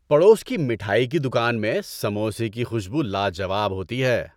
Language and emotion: Urdu, happy